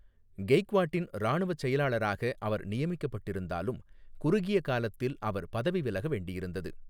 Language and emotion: Tamil, neutral